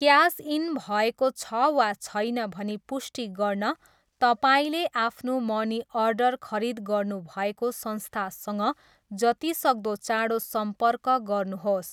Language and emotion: Nepali, neutral